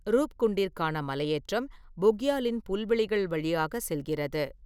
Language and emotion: Tamil, neutral